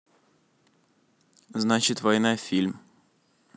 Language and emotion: Russian, neutral